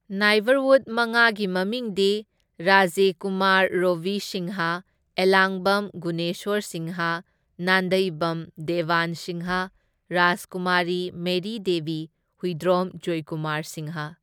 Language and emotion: Manipuri, neutral